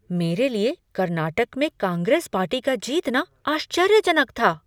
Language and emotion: Hindi, surprised